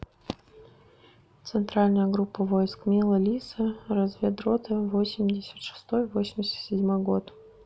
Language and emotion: Russian, neutral